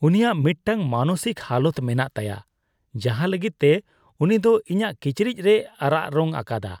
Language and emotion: Santali, disgusted